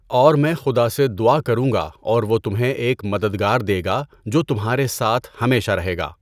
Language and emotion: Urdu, neutral